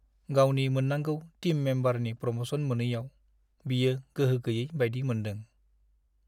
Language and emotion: Bodo, sad